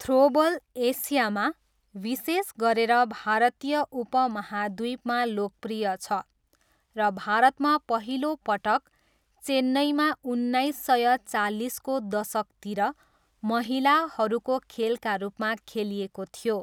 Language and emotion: Nepali, neutral